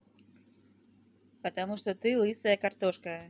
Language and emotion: Russian, neutral